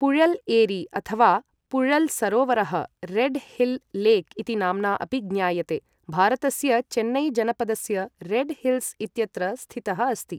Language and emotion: Sanskrit, neutral